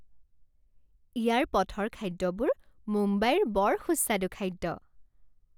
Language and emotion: Assamese, happy